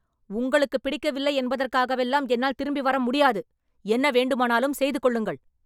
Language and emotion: Tamil, angry